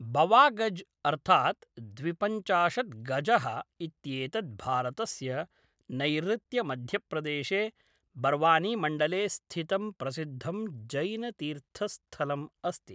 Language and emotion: Sanskrit, neutral